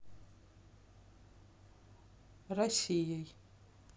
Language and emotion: Russian, neutral